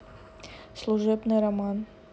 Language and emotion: Russian, neutral